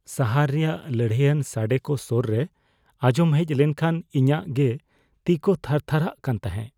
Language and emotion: Santali, fearful